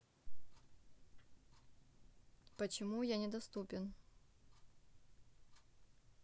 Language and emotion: Russian, neutral